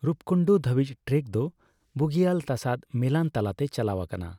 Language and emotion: Santali, neutral